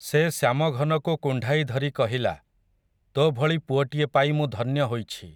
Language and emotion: Odia, neutral